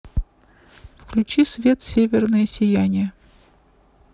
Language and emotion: Russian, neutral